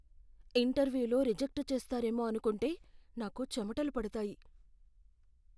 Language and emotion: Telugu, fearful